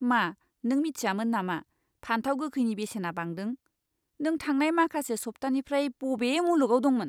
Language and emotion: Bodo, disgusted